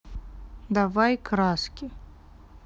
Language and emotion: Russian, neutral